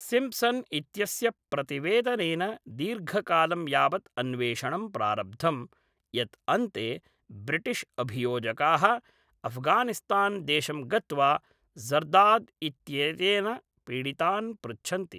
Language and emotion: Sanskrit, neutral